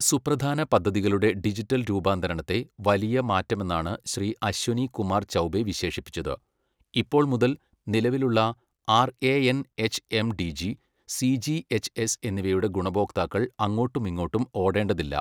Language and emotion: Malayalam, neutral